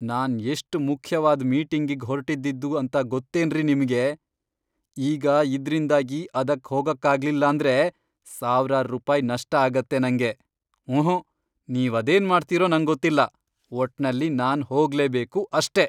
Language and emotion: Kannada, angry